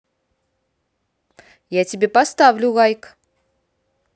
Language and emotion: Russian, positive